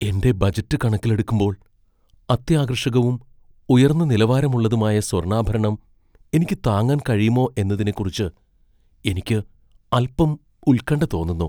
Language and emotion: Malayalam, fearful